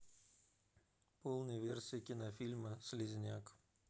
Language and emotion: Russian, neutral